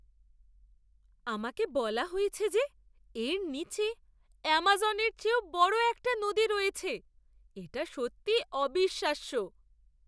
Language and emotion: Bengali, surprised